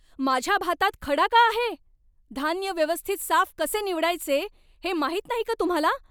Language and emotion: Marathi, angry